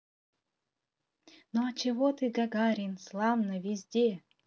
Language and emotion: Russian, positive